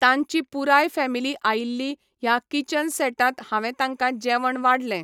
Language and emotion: Goan Konkani, neutral